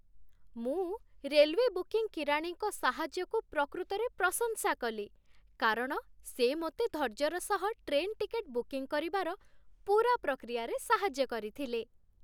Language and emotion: Odia, happy